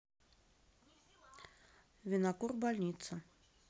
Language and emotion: Russian, neutral